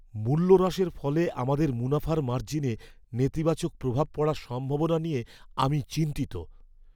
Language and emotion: Bengali, fearful